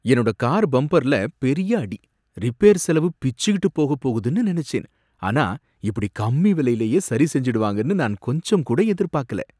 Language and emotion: Tamil, surprised